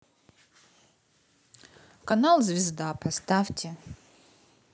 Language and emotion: Russian, neutral